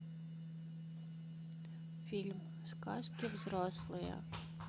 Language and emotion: Russian, neutral